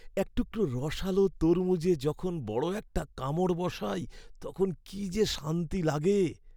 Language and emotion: Bengali, happy